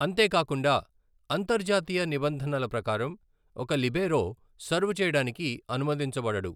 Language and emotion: Telugu, neutral